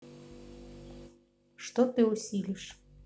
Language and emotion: Russian, neutral